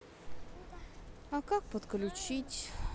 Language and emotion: Russian, sad